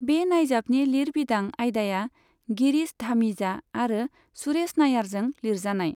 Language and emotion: Bodo, neutral